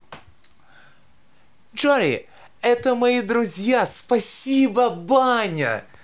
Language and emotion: Russian, positive